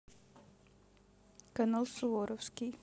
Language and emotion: Russian, neutral